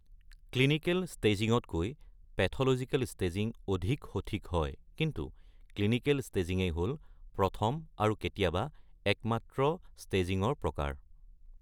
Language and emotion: Assamese, neutral